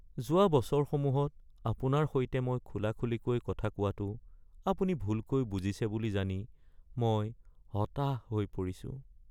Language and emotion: Assamese, sad